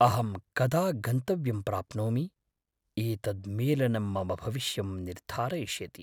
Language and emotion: Sanskrit, fearful